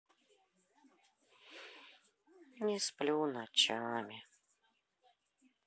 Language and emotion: Russian, sad